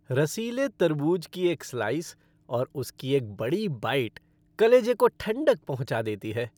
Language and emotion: Hindi, happy